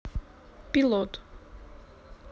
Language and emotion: Russian, neutral